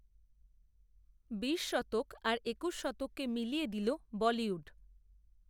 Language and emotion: Bengali, neutral